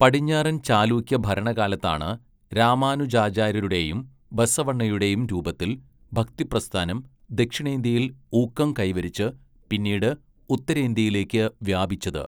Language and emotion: Malayalam, neutral